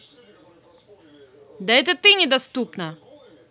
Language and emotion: Russian, angry